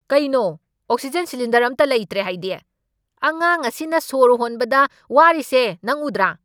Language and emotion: Manipuri, angry